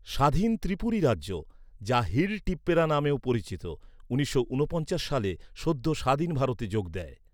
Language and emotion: Bengali, neutral